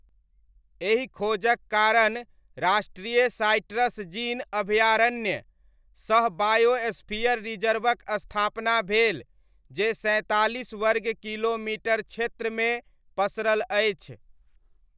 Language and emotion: Maithili, neutral